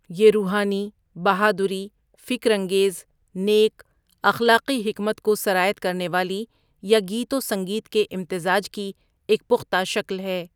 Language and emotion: Urdu, neutral